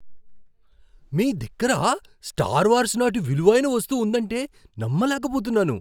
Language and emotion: Telugu, surprised